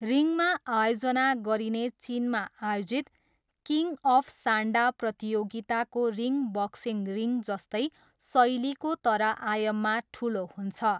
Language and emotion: Nepali, neutral